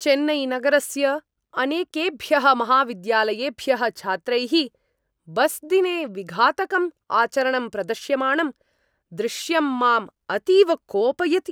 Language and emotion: Sanskrit, angry